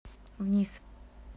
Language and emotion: Russian, neutral